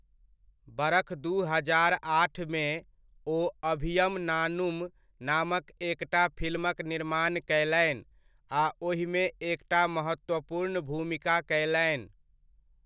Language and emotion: Maithili, neutral